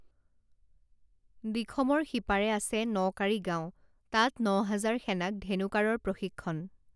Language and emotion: Assamese, neutral